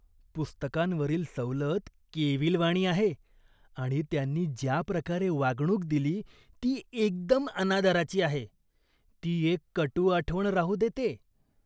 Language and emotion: Marathi, disgusted